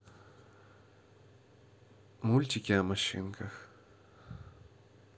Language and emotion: Russian, neutral